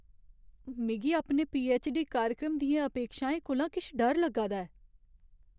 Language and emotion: Dogri, fearful